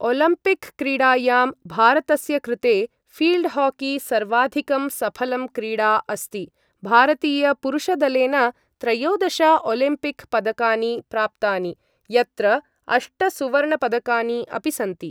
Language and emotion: Sanskrit, neutral